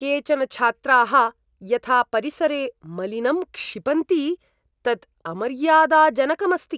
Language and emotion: Sanskrit, disgusted